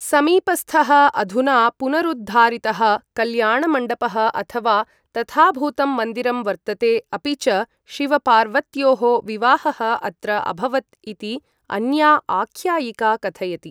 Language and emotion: Sanskrit, neutral